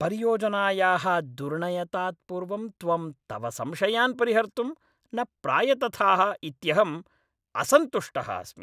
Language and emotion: Sanskrit, angry